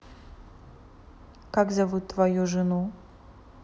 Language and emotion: Russian, neutral